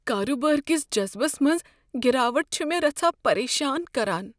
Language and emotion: Kashmiri, fearful